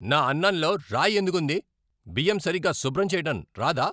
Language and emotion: Telugu, angry